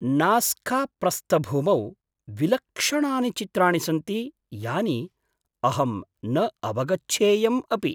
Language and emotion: Sanskrit, surprised